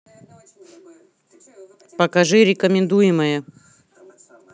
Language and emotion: Russian, angry